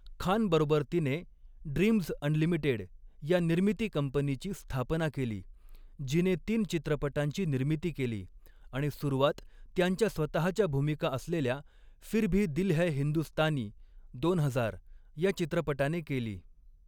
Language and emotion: Marathi, neutral